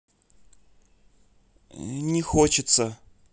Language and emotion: Russian, neutral